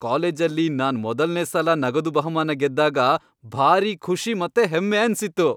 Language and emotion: Kannada, happy